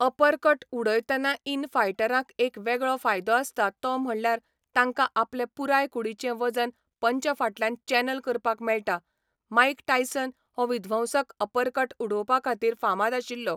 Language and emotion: Goan Konkani, neutral